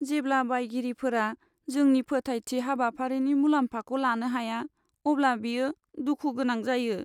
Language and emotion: Bodo, sad